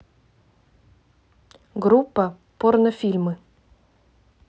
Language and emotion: Russian, neutral